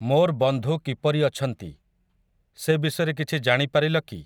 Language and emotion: Odia, neutral